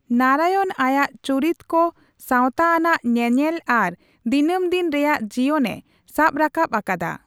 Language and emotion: Santali, neutral